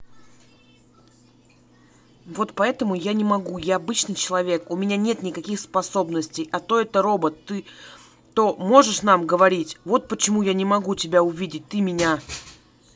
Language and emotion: Russian, angry